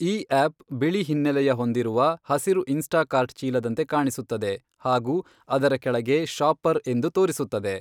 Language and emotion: Kannada, neutral